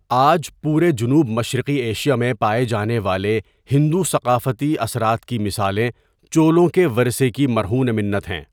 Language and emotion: Urdu, neutral